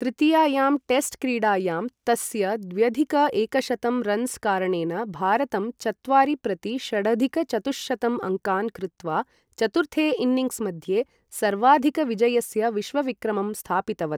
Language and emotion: Sanskrit, neutral